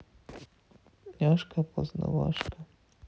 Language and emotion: Russian, sad